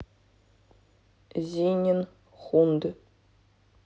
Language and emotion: Russian, neutral